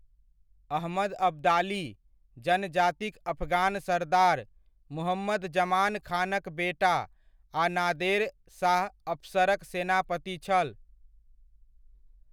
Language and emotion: Maithili, neutral